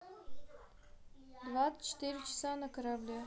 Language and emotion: Russian, neutral